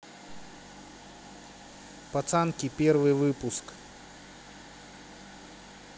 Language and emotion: Russian, neutral